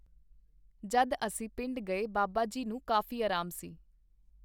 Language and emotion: Punjabi, neutral